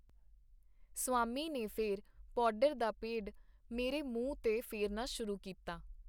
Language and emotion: Punjabi, neutral